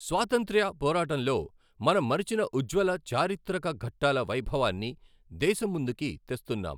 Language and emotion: Telugu, neutral